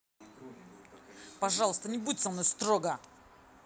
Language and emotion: Russian, angry